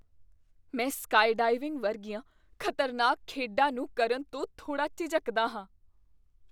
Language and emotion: Punjabi, fearful